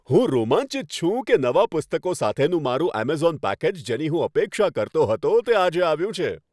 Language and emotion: Gujarati, happy